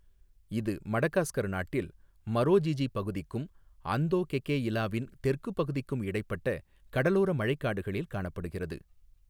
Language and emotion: Tamil, neutral